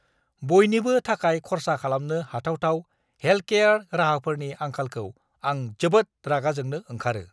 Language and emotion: Bodo, angry